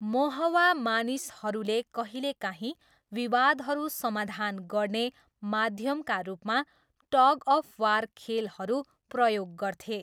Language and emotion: Nepali, neutral